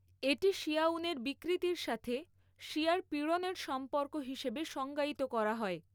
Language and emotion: Bengali, neutral